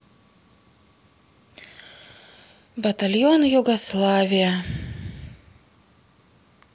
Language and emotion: Russian, sad